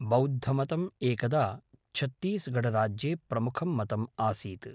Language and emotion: Sanskrit, neutral